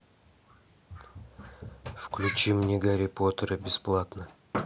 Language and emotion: Russian, neutral